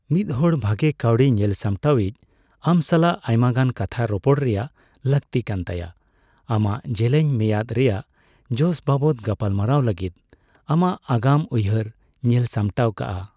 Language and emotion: Santali, neutral